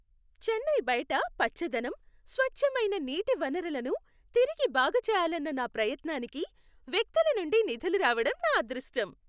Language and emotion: Telugu, happy